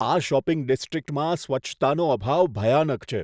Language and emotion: Gujarati, disgusted